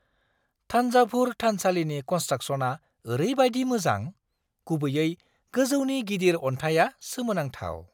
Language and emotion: Bodo, surprised